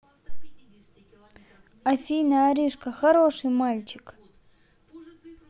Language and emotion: Russian, neutral